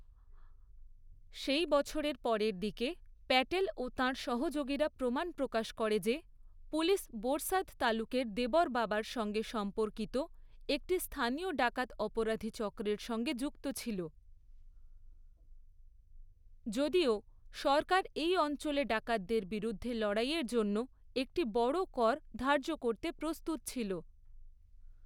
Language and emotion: Bengali, neutral